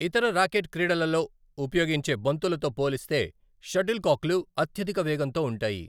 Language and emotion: Telugu, neutral